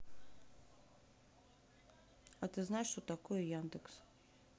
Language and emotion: Russian, neutral